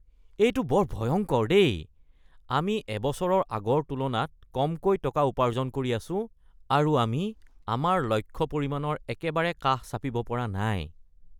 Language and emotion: Assamese, disgusted